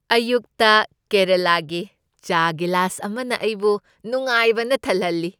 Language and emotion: Manipuri, happy